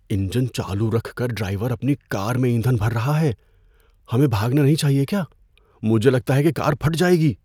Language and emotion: Urdu, fearful